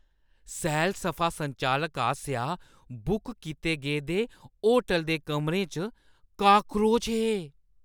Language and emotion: Dogri, disgusted